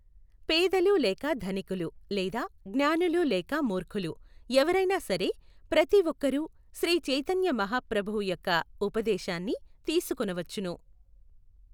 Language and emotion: Telugu, neutral